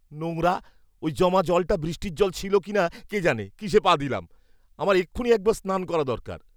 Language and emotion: Bengali, disgusted